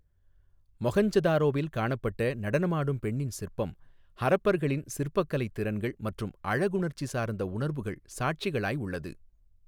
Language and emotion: Tamil, neutral